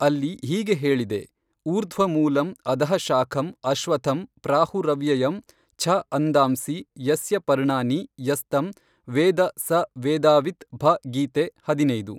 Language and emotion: Kannada, neutral